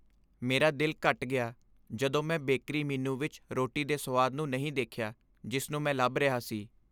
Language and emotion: Punjabi, sad